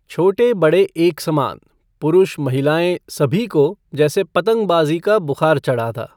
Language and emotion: Hindi, neutral